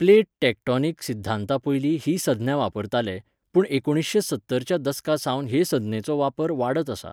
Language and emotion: Goan Konkani, neutral